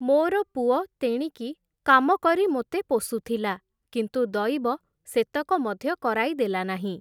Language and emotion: Odia, neutral